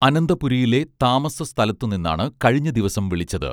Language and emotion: Malayalam, neutral